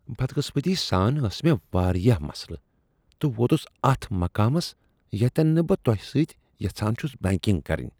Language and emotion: Kashmiri, disgusted